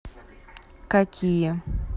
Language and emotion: Russian, neutral